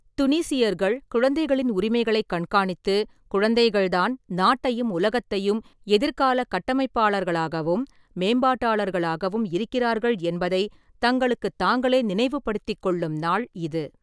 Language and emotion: Tamil, neutral